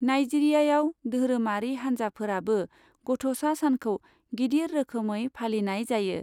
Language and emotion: Bodo, neutral